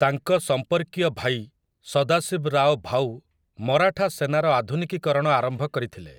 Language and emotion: Odia, neutral